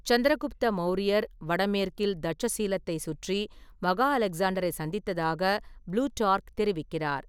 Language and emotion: Tamil, neutral